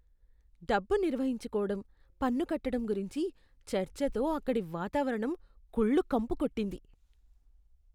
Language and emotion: Telugu, disgusted